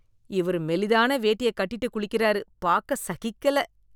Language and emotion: Tamil, disgusted